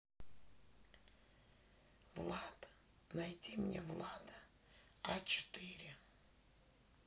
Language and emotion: Russian, neutral